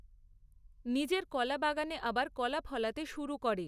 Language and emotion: Bengali, neutral